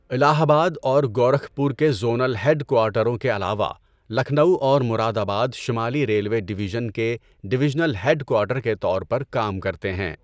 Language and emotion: Urdu, neutral